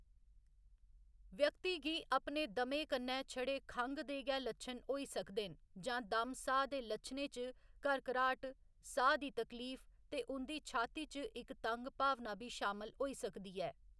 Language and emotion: Dogri, neutral